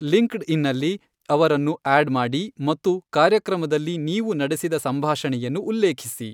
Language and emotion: Kannada, neutral